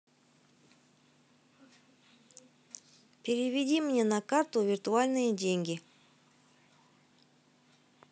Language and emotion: Russian, neutral